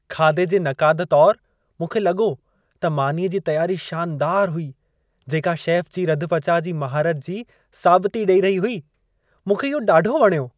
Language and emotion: Sindhi, happy